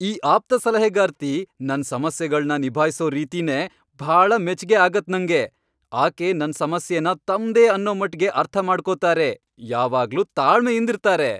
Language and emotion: Kannada, happy